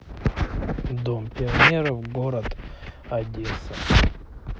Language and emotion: Russian, neutral